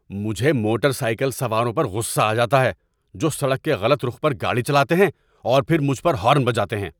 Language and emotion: Urdu, angry